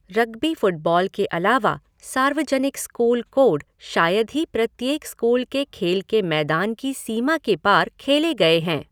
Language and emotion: Hindi, neutral